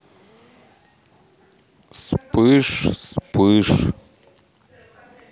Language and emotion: Russian, sad